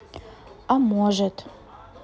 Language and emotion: Russian, neutral